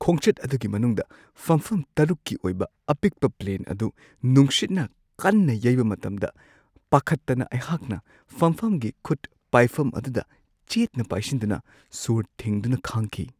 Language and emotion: Manipuri, fearful